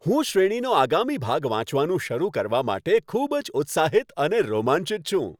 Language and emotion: Gujarati, happy